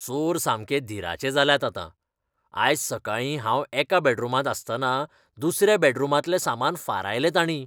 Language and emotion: Goan Konkani, disgusted